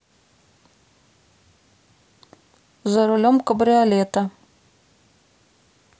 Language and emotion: Russian, neutral